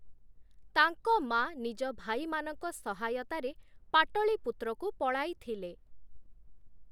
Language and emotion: Odia, neutral